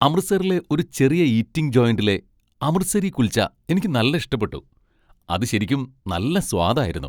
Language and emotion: Malayalam, happy